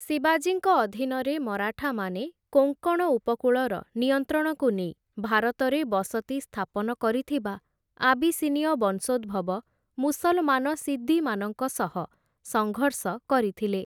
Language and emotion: Odia, neutral